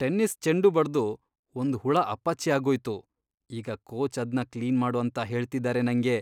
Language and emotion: Kannada, disgusted